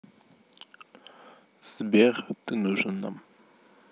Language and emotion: Russian, neutral